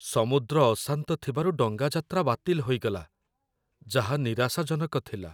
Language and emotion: Odia, sad